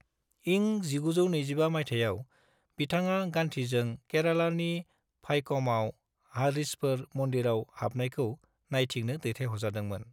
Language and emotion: Bodo, neutral